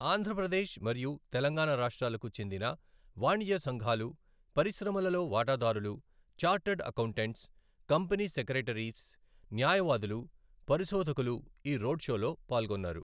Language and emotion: Telugu, neutral